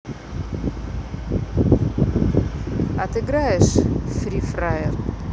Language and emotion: Russian, neutral